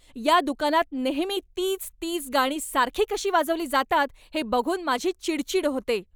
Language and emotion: Marathi, angry